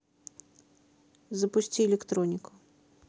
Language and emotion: Russian, neutral